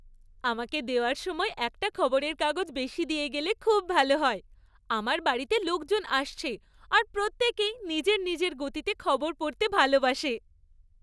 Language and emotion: Bengali, happy